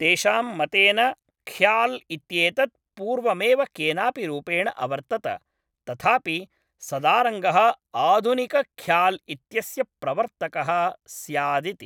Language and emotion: Sanskrit, neutral